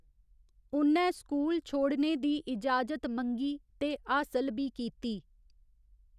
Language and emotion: Dogri, neutral